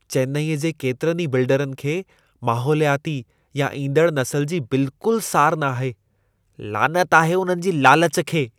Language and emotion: Sindhi, disgusted